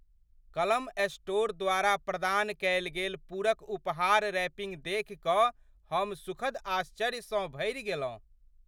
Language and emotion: Maithili, surprised